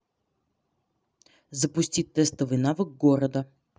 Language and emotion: Russian, neutral